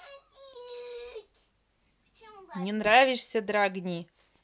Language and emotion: Russian, neutral